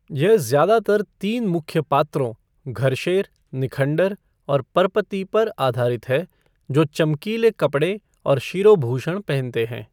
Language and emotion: Hindi, neutral